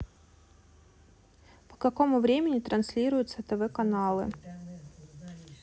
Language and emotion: Russian, neutral